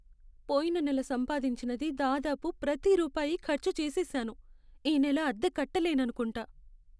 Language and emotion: Telugu, sad